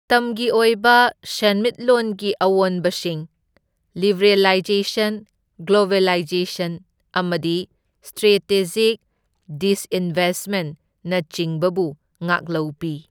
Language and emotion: Manipuri, neutral